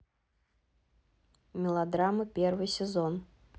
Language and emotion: Russian, neutral